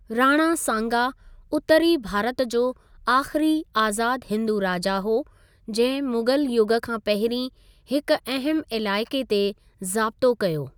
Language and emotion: Sindhi, neutral